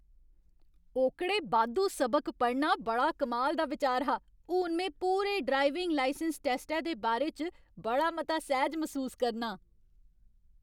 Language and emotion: Dogri, happy